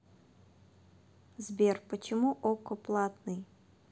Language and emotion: Russian, neutral